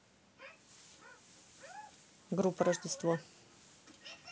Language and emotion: Russian, neutral